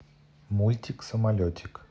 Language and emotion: Russian, neutral